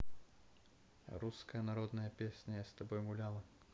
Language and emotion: Russian, neutral